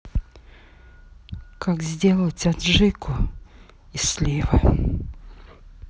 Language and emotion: Russian, angry